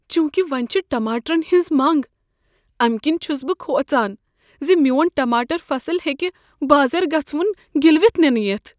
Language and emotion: Kashmiri, fearful